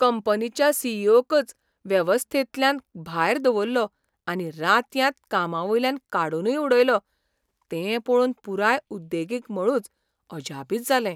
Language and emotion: Goan Konkani, surprised